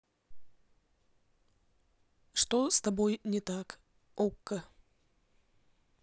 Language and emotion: Russian, neutral